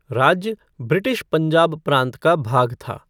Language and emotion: Hindi, neutral